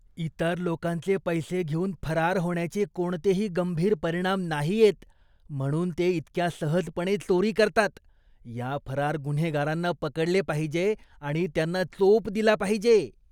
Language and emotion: Marathi, disgusted